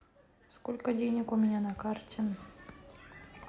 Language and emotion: Russian, neutral